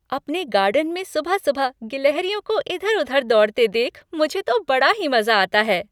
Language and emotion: Hindi, happy